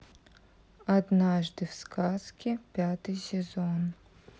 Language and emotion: Russian, neutral